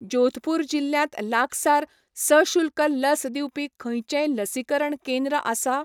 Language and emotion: Goan Konkani, neutral